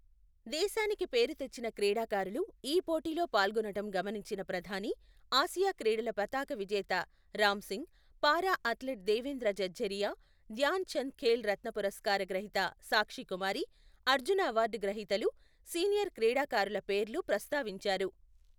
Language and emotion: Telugu, neutral